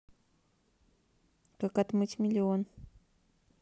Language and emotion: Russian, neutral